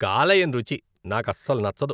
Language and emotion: Telugu, disgusted